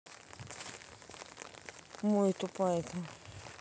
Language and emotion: Russian, neutral